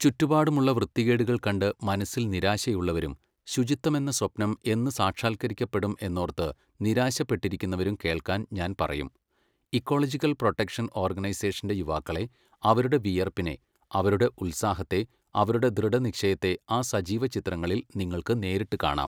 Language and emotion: Malayalam, neutral